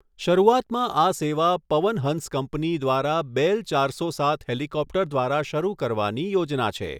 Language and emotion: Gujarati, neutral